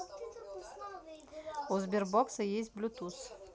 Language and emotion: Russian, neutral